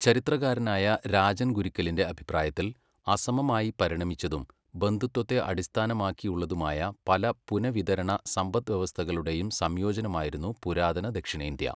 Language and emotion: Malayalam, neutral